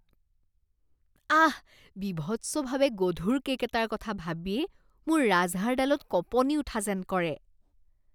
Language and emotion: Assamese, disgusted